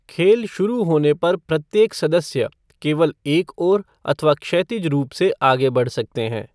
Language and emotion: Hindi, neutral